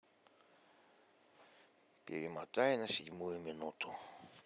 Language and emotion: Russian, sad